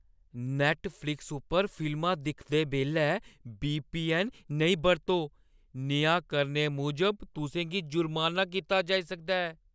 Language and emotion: Dogri, fearful